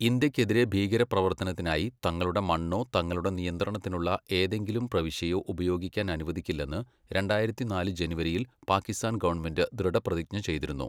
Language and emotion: Malayalam, neutral